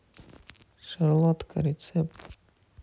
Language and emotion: Russian, neutral